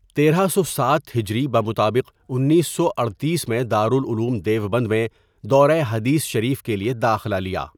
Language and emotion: Urdu, neutral